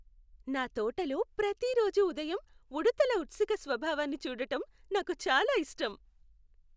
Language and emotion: Telugu, happy